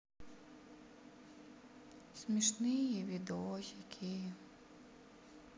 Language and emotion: Russian, sad